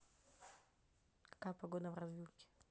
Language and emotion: Russian, neutral